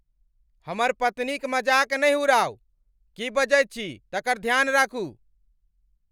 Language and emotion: Maithili, angry